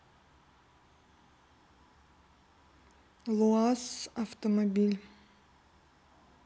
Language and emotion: Russian, neutral